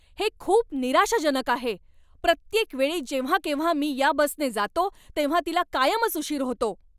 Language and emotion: Marathi, angry